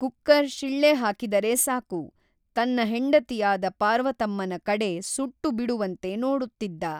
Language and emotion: Kannada, neutral